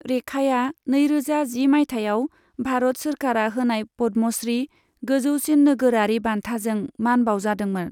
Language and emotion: Bodo, neutral